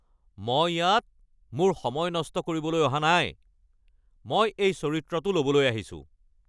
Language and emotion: Assamese, angry